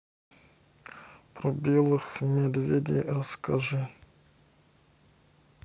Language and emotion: Russian, sad